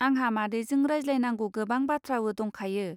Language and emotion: Bodo, neutral